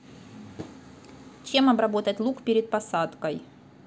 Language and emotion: Russian, neutral